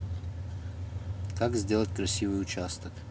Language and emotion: Russian, neutral